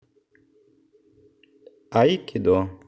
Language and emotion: Russian, neutral